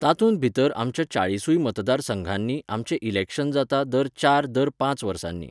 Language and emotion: Goan Konkani, neutral